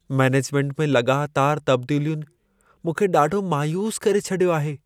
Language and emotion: Sindhi, sad